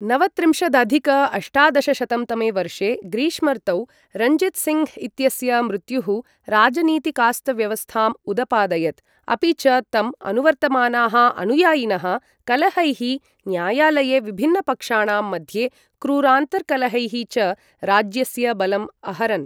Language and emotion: Sanskrit, neutral